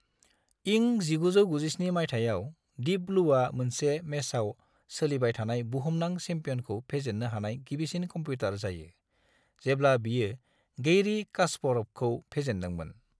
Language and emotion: Bodo, neutral